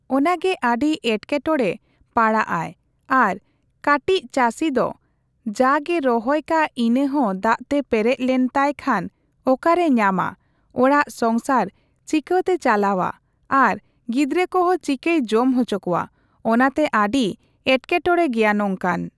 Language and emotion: Santali, neutral